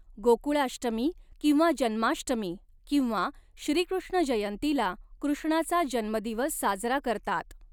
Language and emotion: Marathi, neutral